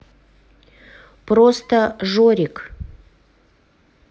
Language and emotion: Russian, neutral